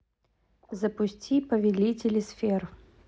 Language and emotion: Russian, neutral